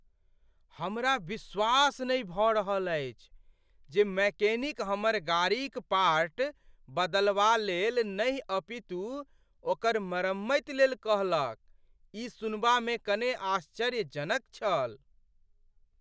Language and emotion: Maithili, surprised